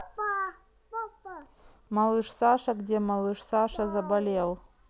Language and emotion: Russian, neutral